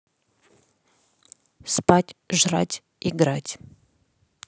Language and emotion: Russian, neutral